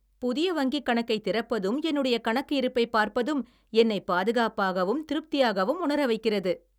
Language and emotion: Tamil, happy